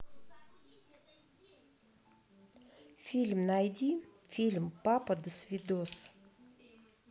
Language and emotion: Russian, neutral